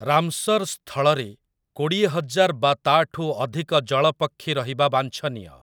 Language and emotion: Odia, neutral